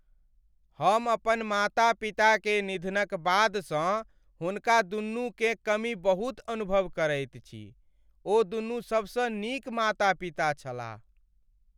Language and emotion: Maithili, sad